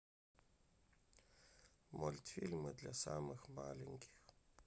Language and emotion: Russian, sad